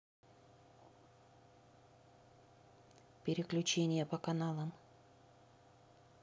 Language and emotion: Russian, neutral